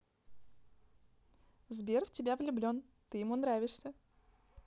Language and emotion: Russian, positive